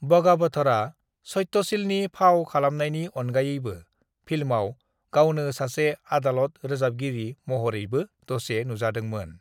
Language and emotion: Bodo, neutral